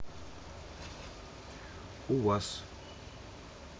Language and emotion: Russian, neutral